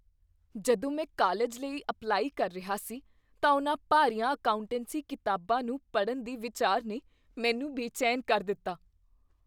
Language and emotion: Punjabi, fearful